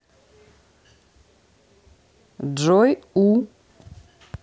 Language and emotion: Russian, neutral